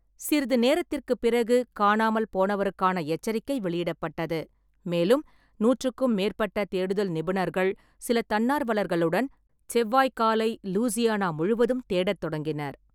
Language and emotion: Tamil, neutral